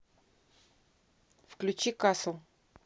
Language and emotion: Russian, neutral